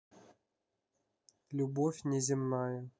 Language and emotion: Russian, neutral